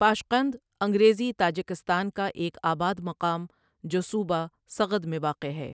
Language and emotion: Urdu, neutral